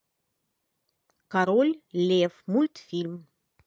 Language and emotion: Russian, positive